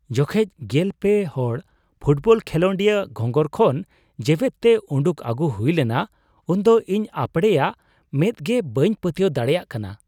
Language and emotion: Santali, surprised